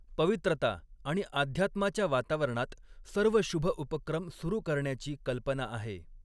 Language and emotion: Marathi, neutral